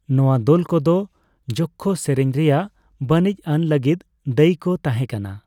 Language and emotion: Santali, neutral